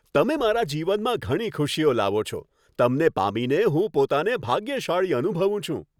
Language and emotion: Gujarati, happy